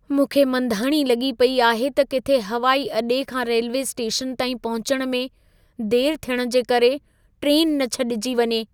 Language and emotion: Sindhi, fearful